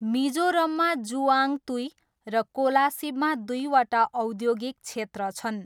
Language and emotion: Nepali, neutral